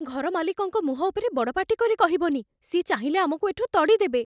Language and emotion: Odia, fearful